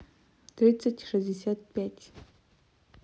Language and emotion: Russian, neutral